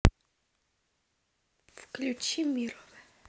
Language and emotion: Russian, neutral